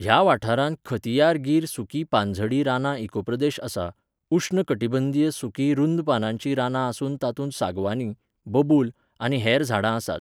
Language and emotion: Goan Konkani, neutral